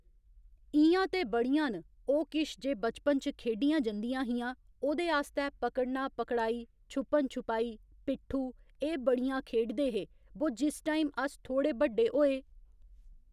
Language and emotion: Dogri, neutral